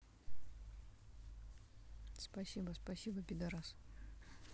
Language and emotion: Russian, neutral